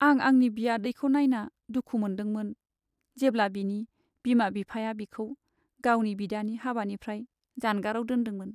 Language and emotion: Bodo, sad